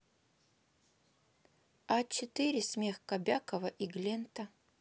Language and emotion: Russian, neutral